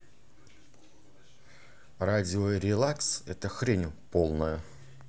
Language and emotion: Russian, angry